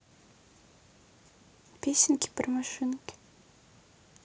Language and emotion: Russian, neutral